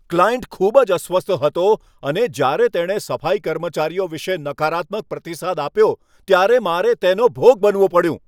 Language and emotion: Gujarati, angry